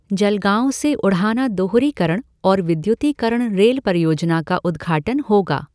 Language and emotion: Hindi, neutral